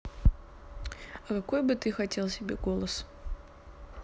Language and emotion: Russian, neutral